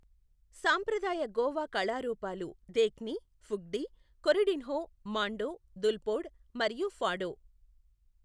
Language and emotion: Telugu, neutral